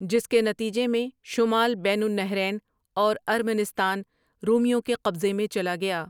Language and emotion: Urdu, neutral